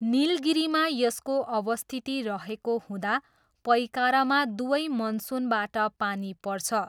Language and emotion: Nepali, neutral